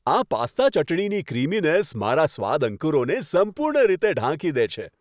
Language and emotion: Gujarati, happy